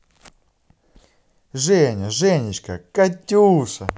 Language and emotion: Russian, positive